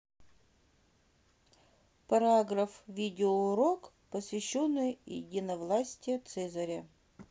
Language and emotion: Russian, neutral